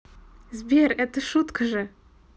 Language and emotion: Russian, positive